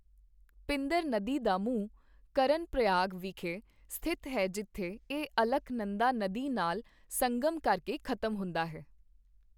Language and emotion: Punjabi, neutral